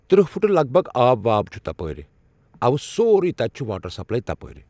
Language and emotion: Kashmiri, neutral